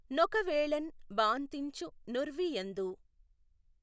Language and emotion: Telugu, neutral